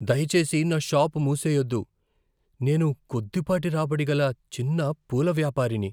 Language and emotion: Telugu, fearful